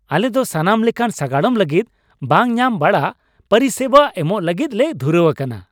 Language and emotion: Santali, happy